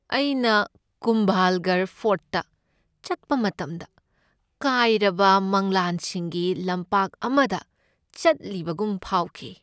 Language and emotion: Manipuri, sad